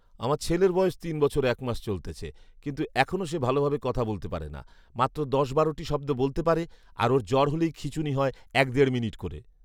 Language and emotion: Bengali, neutral